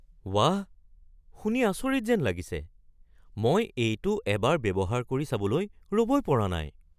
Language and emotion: Assamese, surprised